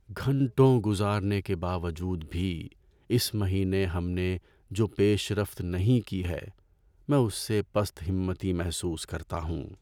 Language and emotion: Urdu, sad